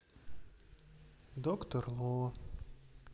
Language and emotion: Russian, sad